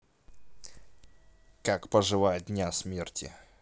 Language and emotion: Russian, neutral